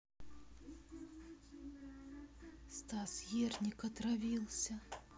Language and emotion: Russian, sad